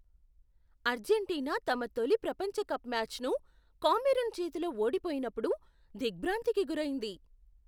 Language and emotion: Telugu, surprised